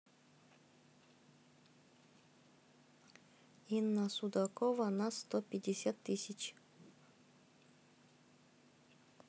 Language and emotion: Russian, neutral